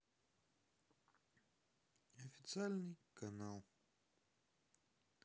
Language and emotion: Russian, sad